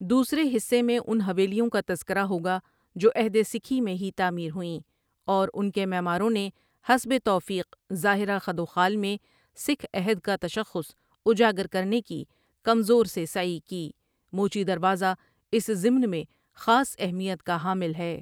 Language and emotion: Urdu, neutral